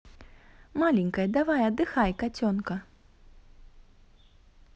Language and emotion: Russian, positive